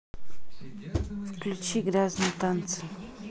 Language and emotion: Russian, neutral